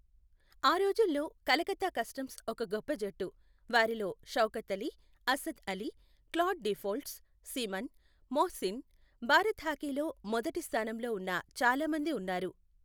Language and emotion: Telugu, neutral